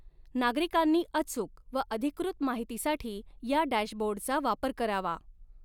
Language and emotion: Marathi, neutral